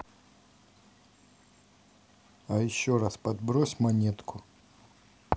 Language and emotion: Russian, neutral